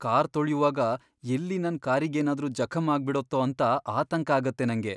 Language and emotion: Kannada, fearful